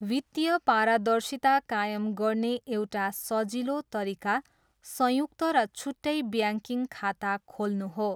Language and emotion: Nepali, neutral